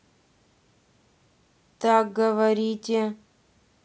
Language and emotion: Russian, neutral